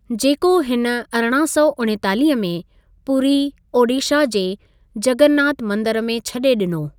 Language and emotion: Sindhi, neutral